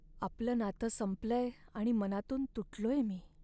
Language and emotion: Marathi, sad